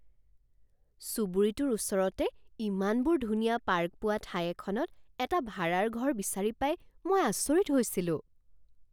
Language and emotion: Assamese, surprised